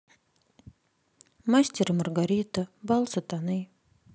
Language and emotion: Russian, sad